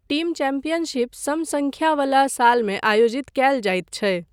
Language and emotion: Maithili, neutral